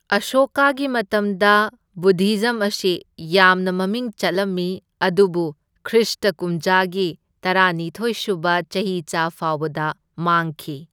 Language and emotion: Manipuri, neutral